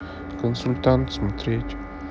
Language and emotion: Russian, neutral